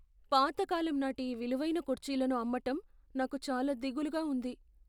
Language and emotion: Telugu, fearful